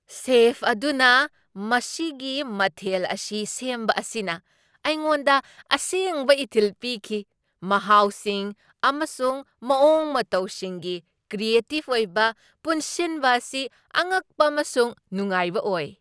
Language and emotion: Manipuri, surprised